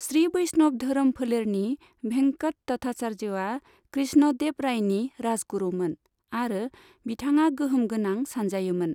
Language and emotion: Bodo, neutral